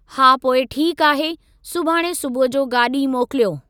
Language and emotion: Sindhi, neutral